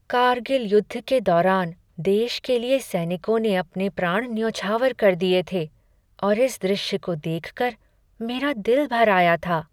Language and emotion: Hindi, sad